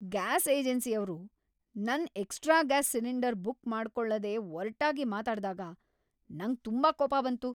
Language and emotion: Kannada, angry